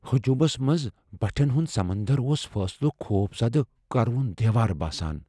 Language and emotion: Kashmiri, fearful